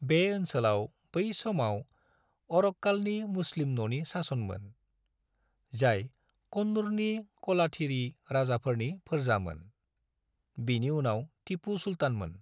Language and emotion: Bodo, neutral